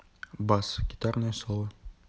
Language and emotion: Russian, neutral